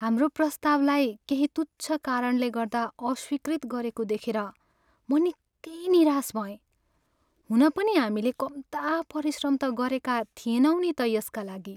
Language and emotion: Nepali, sad